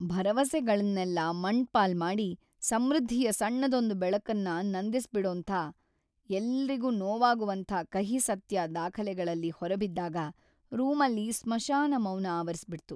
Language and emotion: Kannada, sad